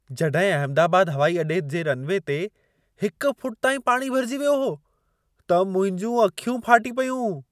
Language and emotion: Sindhi, surprised